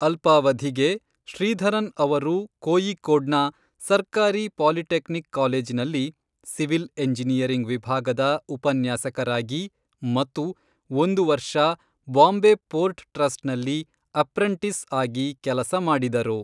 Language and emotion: Kannada, neutral